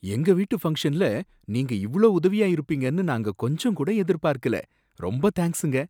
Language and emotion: Tamil, surprised